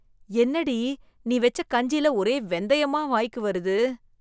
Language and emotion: Tamil, disgusted